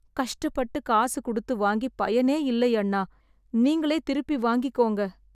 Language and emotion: Tamil, sad